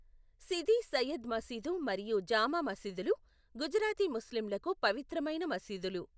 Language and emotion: Telugu, neutral